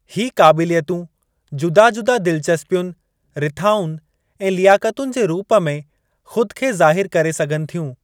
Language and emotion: Sindhi, neutral